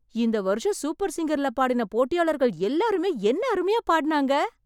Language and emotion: Tamil, surprised